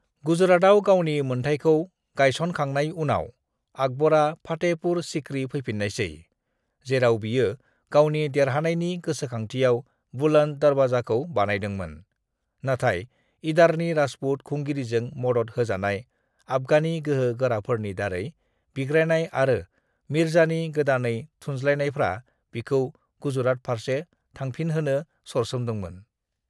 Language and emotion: Bodo, neutral